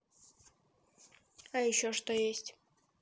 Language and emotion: Russian, neutral